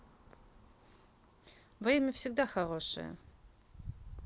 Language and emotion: Russian, neutral